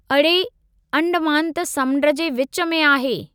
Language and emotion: Sindhi, neutral